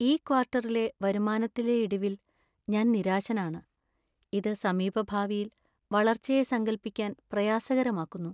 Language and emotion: Malayalam, sad